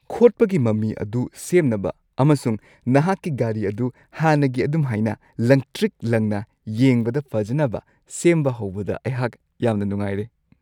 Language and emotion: Manipuri, happy